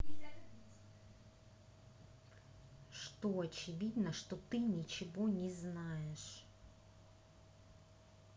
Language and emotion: Russian, angry